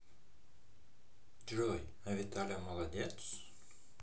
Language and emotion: Russian, positive